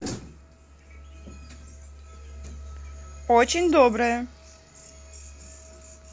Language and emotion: Russian, positive